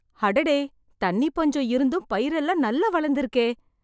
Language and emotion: Tamil, surprised